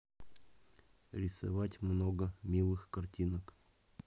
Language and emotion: Russian, neutral